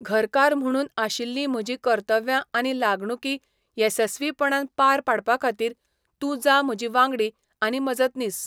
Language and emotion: Goan Konkani, neutral